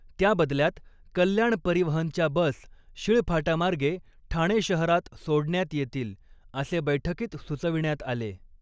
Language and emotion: Marathi, neutral